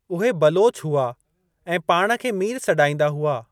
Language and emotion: Sindhi, neutral